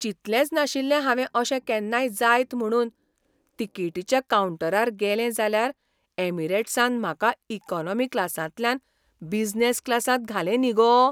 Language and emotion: Goan Konkani, surprised